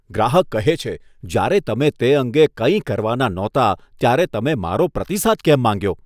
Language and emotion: Gujarati, disgusted